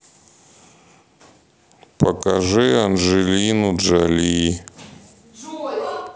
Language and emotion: Russian, sad